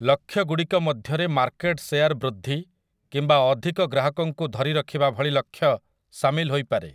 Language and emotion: Odia, neutral